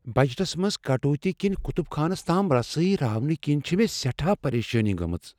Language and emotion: Kashmiri, fearful